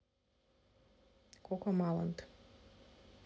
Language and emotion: Russian, neutral